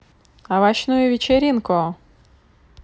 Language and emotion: Russian, positive